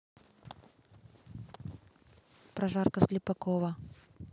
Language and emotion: Russian, neutral